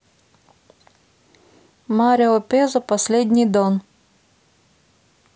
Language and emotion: Russian, neutral